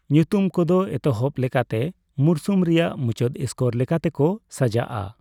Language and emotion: Santali, neutral